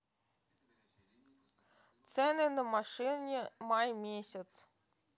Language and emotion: Russian, neutral